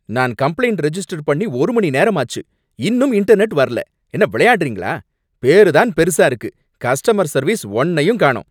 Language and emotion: Tamil, angry